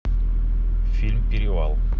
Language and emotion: Russian, neutral